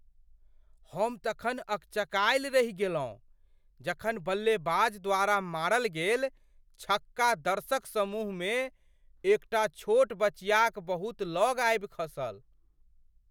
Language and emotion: Maithili, surprised